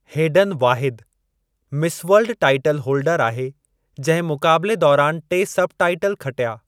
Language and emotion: Sindhi, neutral